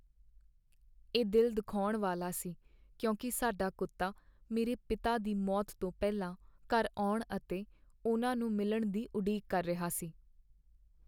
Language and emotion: Punjabi, sad